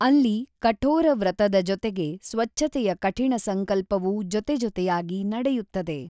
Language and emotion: Kannada, neutral